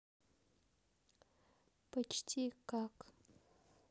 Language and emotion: Russian, neutral